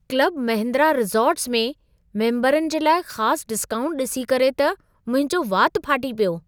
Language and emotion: Sindhi, surprised